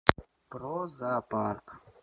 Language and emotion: Russian, neutral